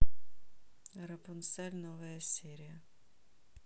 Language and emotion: Russian, neutral